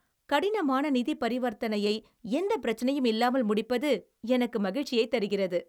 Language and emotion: Tamil, happy